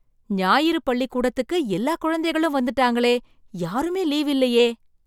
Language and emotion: Tamil, surprised